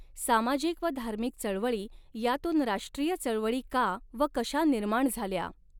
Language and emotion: Marathi, neutral